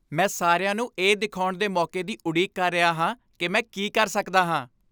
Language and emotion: Punjabi, happy